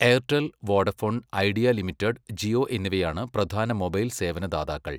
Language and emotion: Malayalam, neutral